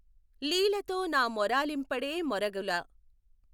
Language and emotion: Telugu, neutral